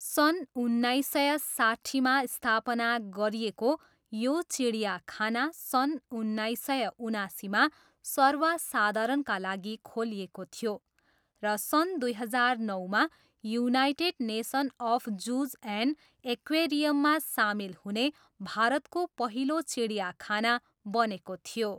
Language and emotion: Nepali, neutral